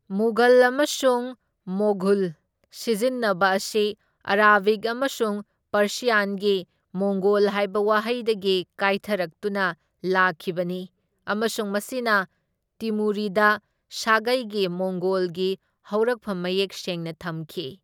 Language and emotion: Manipuri, neutral